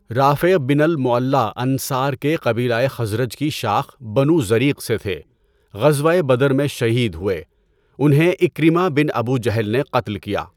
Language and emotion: Urdu, neutral